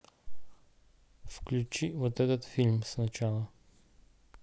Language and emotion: Russian, neutral